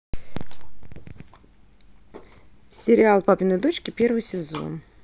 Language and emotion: Russian, neutral